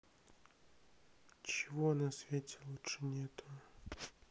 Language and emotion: Russian, sad